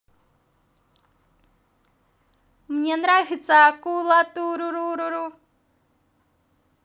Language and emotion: Russian, positive